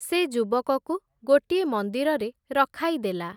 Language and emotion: Odia, neutral